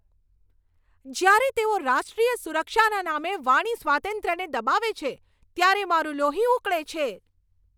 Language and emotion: Gujarati, angry